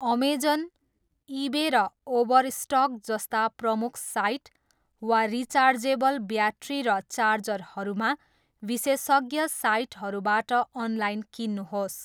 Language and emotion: Nepali, neutral